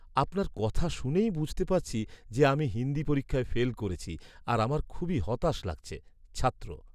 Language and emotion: Bengali, sad